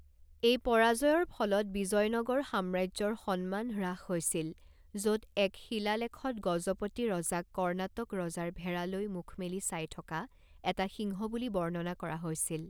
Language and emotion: Assamese, neutral